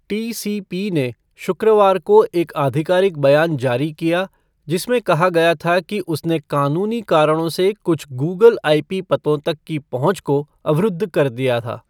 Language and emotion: Hindi, neutral